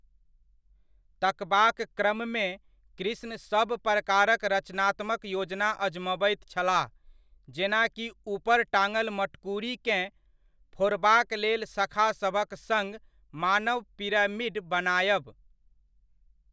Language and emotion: Maithili, neutral